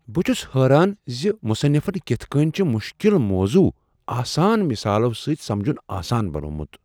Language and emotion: Kashmiri, surprised